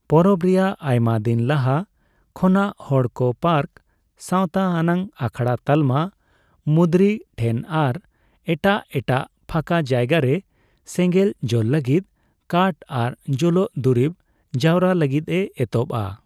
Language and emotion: Santali, neutral